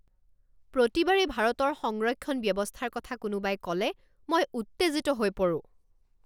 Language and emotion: Assamese, angry